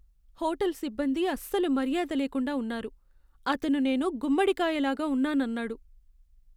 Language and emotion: Telugu, sad